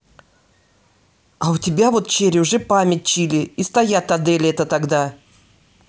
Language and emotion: Russian, angry